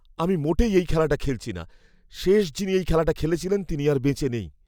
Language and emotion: Bengali, fearful